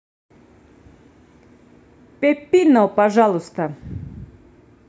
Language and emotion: Russian, neutral